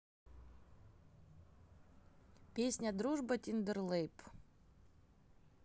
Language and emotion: Russian, neutral